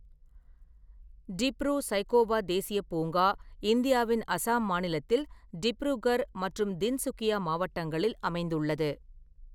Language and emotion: Tamil, neutral